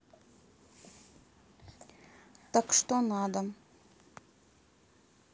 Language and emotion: Russian, neutral